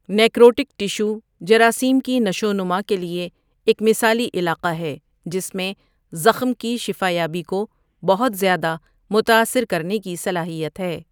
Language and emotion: Urdu, neutral